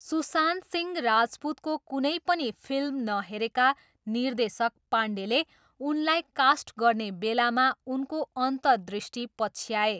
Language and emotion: Nepali, neutral